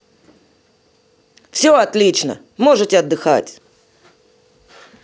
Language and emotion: Russian, positive